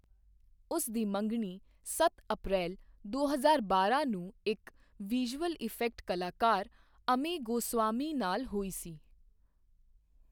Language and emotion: Punjabi, neutral